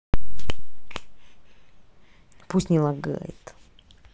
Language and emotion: Russian, angry